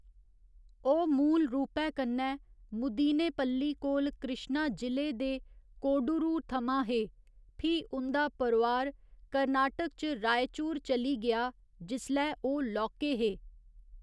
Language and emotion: Dogri, neutral